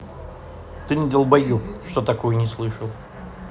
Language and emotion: Russian, angry